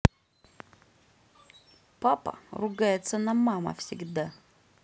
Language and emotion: Russian, angry